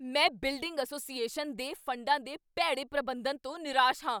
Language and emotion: Punjabi, angry